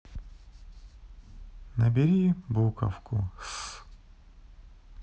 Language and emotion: Russian, sad